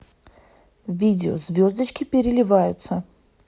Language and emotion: Russian, neutral